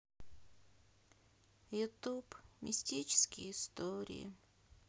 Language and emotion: Russian, sad